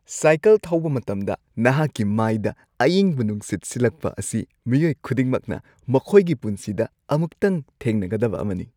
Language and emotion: Manipuri, happy